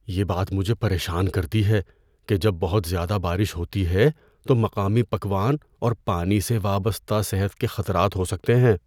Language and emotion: Urdu, fearful